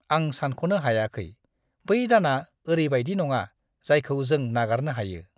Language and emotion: Bodo, disgusted